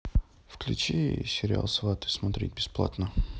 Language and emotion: Russian, neutral